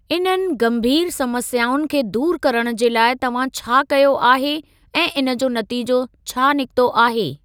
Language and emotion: Sindhi, neutral